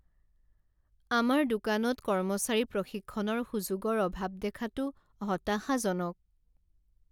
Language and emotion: Assamese, sad